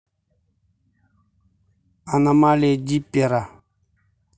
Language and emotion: Russian, neutral